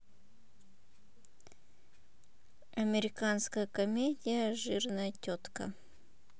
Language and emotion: Russian, neutral